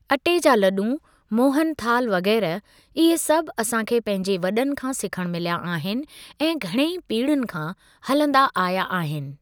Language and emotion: Sindhi, neutral